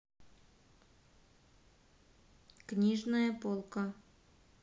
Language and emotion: Russian, neutral